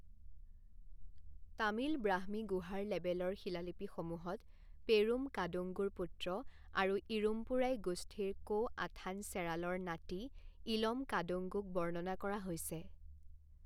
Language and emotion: Assamese, neutral